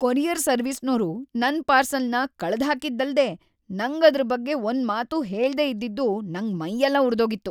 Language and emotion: Kannada, angry